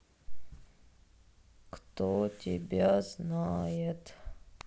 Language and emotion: Russian, sad